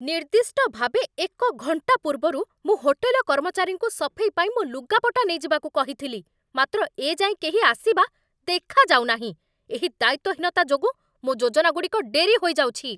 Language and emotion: Odia, angry